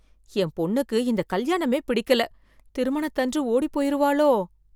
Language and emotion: Tamil, fearful